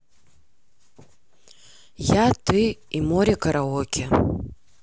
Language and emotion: Russian, neutral